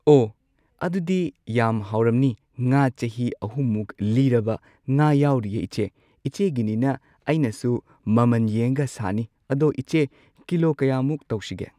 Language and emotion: Manipuri, neutral